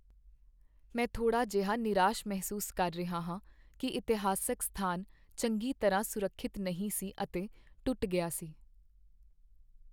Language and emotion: Punjabi, sad